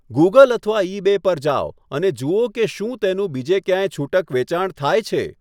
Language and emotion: Gujarati, neutral